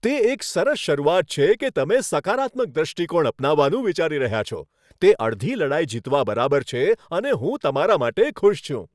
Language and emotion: Gujarati, happy